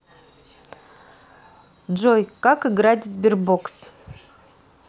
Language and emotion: Russian, neutral